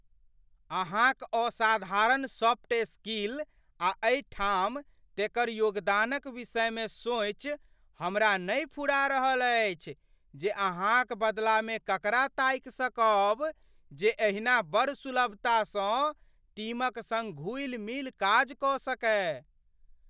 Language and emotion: Maithili, fearful